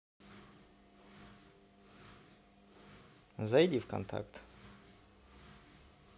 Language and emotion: Russian, neutral